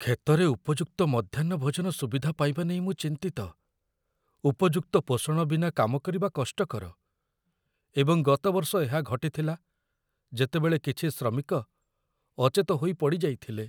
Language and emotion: Odia, fearful